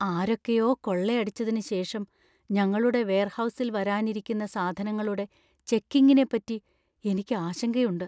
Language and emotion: Malayalam, fearful